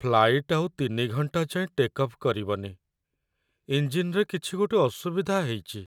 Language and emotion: Odia, sad